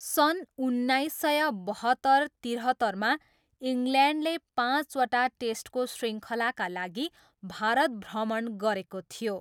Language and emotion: Nepali, neutral